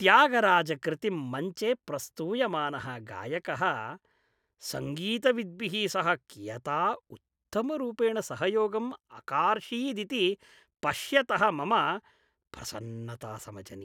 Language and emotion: Sanskrit, happy